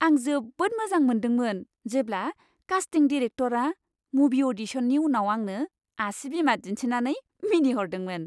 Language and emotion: Bodo, happy